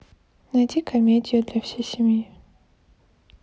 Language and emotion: Russian, neutral